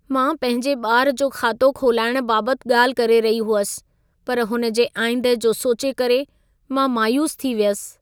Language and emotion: Sindhi, sad